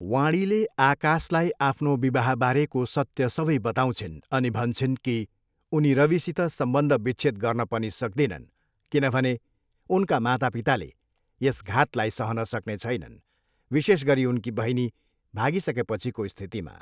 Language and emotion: Nepali, neutral